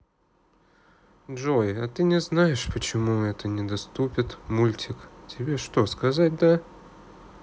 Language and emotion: Russian, sad